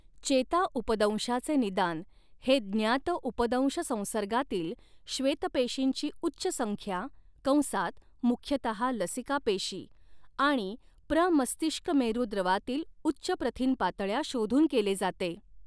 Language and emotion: Marathi, neutral